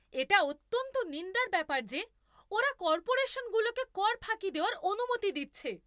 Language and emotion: Bengali, angry